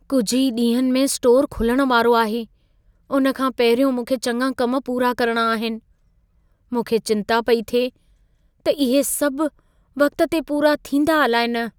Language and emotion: Sindhi, fearful